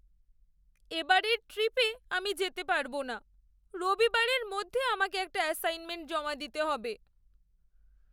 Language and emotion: Bengali, sad